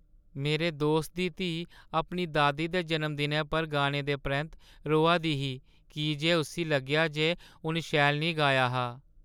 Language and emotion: Dogri, sad